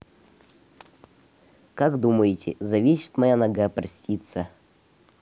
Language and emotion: Russian, neutral